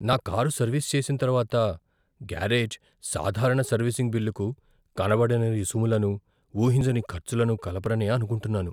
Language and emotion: Telugu, fearful